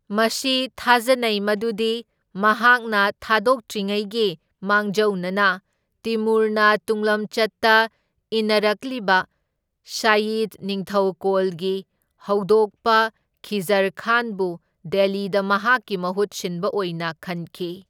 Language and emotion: Manipuri, neutral